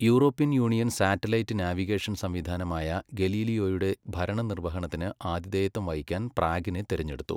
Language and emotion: Malayalam, neutral